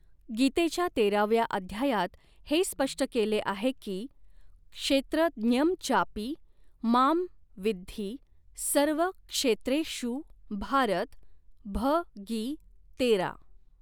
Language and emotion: Marathi, neutral